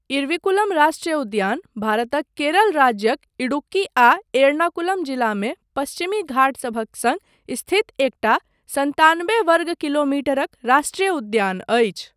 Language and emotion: Maithili, neutral